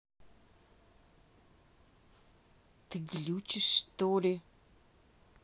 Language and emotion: Russian, angry